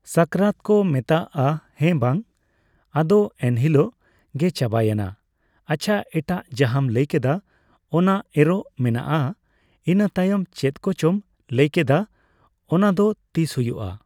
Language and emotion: Santali, neutral